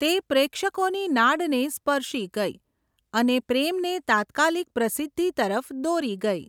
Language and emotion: Gujarati, neutral